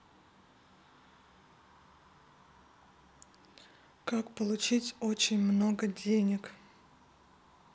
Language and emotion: Russian, neutral